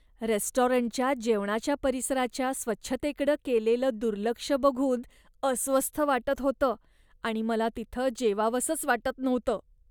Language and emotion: Marathi, disgusted